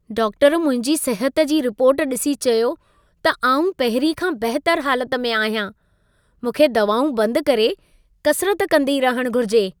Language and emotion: Sindhi, happy